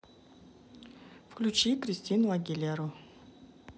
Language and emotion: Russian, neutral